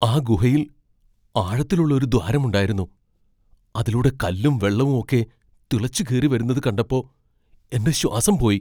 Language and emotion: Malayalam, fearful